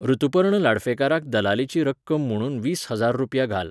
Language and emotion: Goan Konkani, neutral